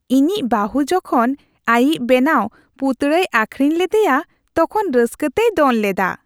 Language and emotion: Santali, happy